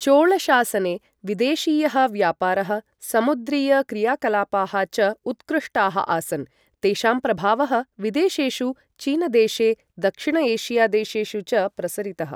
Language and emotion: Sanskrit, neutral